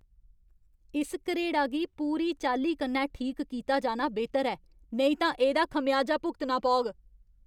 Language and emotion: Dogri, angry